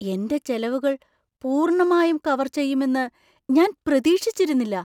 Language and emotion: Malayalam, surprised